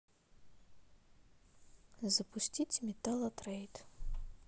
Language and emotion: Russian, neutral